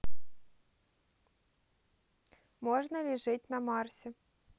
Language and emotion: Russian, neutral